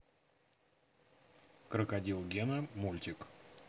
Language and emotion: Russian, neutral